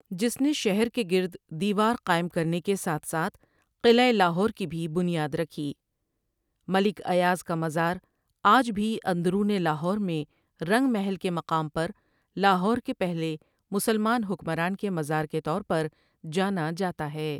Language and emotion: Urdu, neutral